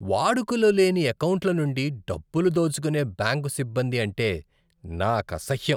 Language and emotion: Telugu, disgusted